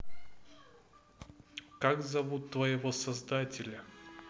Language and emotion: Russian, neutral